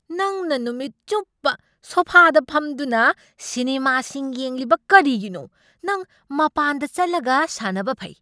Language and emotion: Manipuri, angry